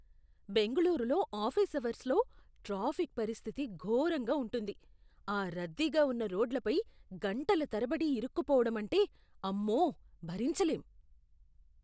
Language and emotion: Telugu, disgusted